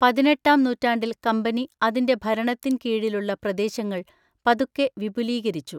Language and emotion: Malayalam, neutral